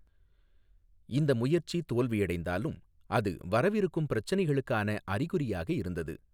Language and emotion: Tamil, neutral